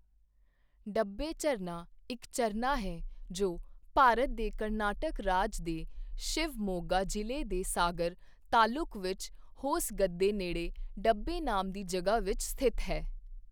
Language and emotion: Punjabi, neutral